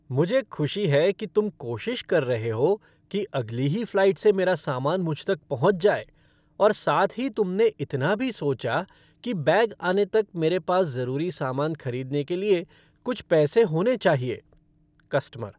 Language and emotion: Hindi, happy